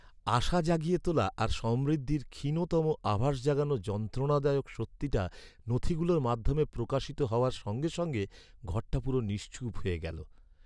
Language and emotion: Bengali, sad